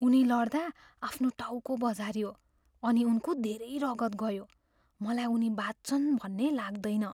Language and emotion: Nepali, fearful